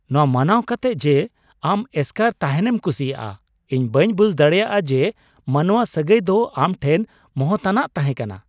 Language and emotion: Santali, surprised